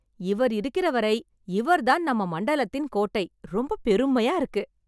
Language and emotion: Tamil, happy